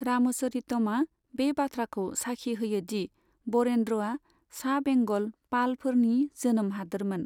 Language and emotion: Bodo, neutral